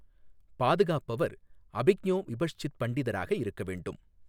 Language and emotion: Tamil, neutral